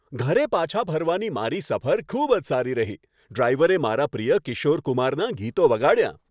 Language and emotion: Gujarati, happy